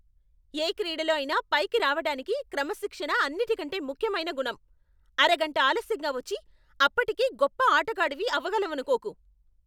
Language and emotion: Telugu, angry